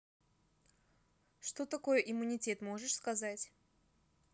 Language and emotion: Russian, neutral